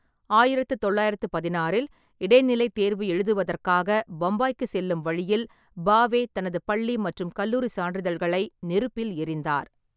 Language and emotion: Tamil, neutral